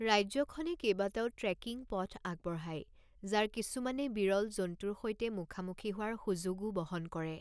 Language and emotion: Assamese, neutral